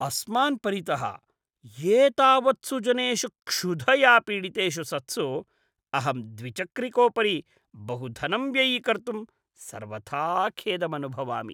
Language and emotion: Sanskrit, disgusted